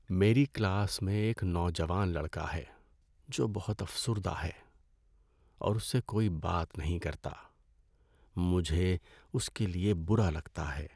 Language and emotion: Urdu, sad